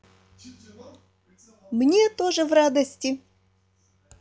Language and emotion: Russian, positive